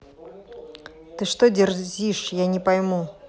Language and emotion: Russian, angry